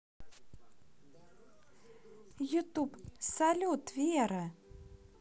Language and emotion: Russian, positive